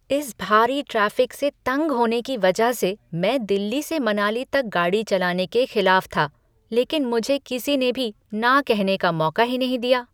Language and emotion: Hindi, disgusted